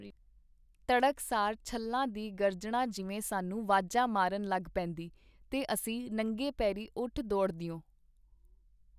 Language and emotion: Punjabi, neutral